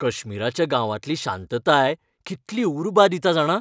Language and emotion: Goan Konkani, happy